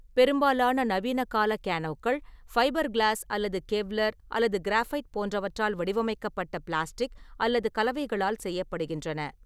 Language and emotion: Tamil, neutral